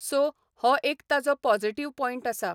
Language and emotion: Goan Konkani, neutral